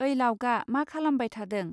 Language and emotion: Bodo, neutral